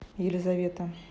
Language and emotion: Russian, neutral